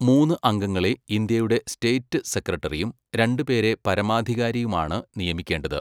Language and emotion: Malayalam, neutral